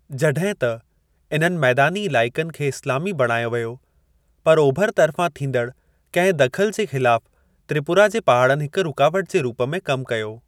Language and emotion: Sindhi, neutral